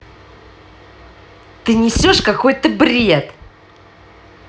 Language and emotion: Russian, angry